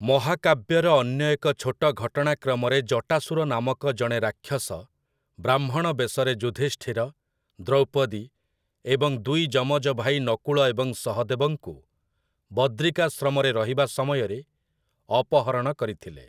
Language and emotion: Odia, neutral